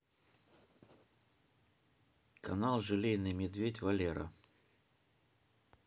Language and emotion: Russian, neutral